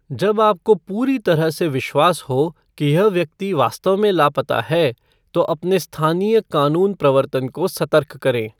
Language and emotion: Hindi, neutral